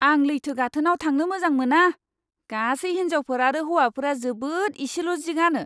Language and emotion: Bodo, disgusted